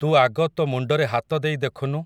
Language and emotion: Odia, neutral